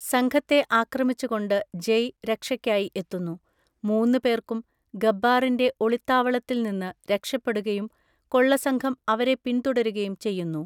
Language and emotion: Malayalam, neutral